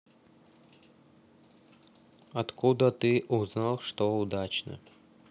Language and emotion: Russian, neutral